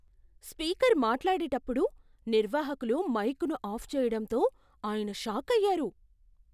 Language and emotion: Telugu, surprised